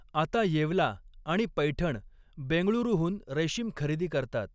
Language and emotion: Marathi, neutral